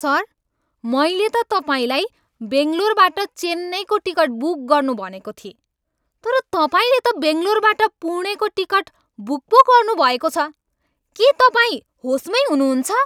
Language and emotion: Nepali, angry